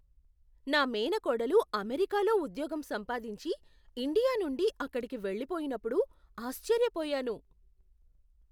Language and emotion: Telugu, surprised